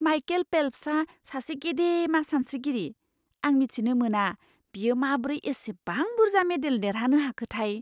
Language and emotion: Bodo, surprised